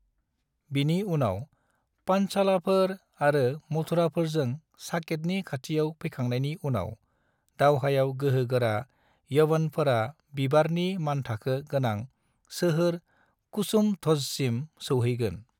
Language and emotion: Bodo, neutral